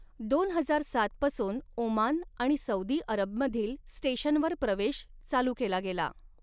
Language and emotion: Marathi, neutral